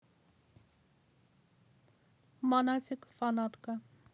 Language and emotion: Russian, neutral